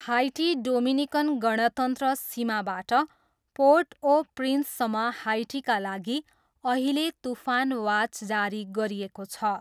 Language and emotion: Nepali, neutral